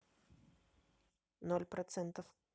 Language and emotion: Russian, neutral